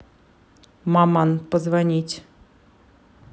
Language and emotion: Russian, neutral